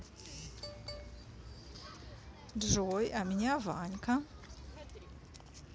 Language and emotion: Russian, positive